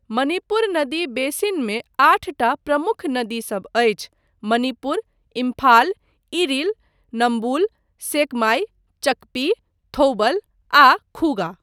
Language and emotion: Maithili, neutral